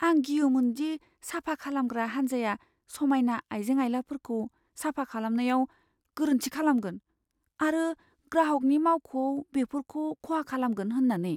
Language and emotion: Bodo, fearful